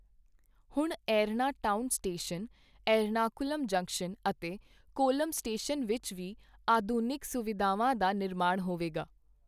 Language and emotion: Punjabi, neutral